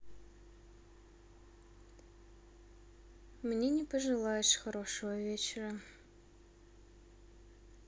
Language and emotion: Russian, sad